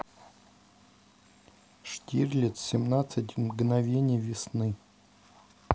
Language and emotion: Russian, neutral